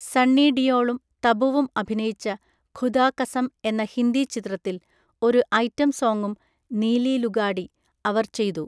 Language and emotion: Malayalam, neutral